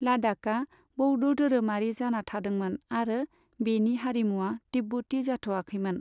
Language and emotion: Bodo, neutral